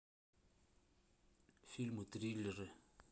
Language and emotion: Russian, neutral